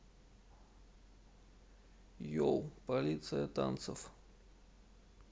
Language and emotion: Russian, neutral